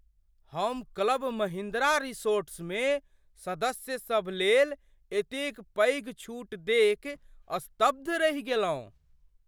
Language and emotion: Maithili, surprised